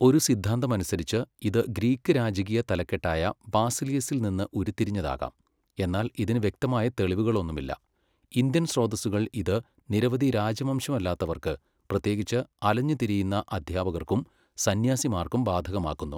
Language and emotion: Malayalam, neutral